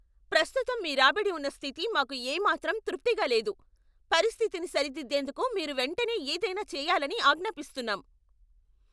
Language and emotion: Telugu, angry